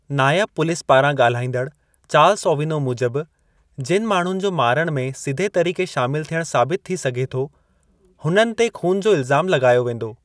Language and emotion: Sindhi, neutral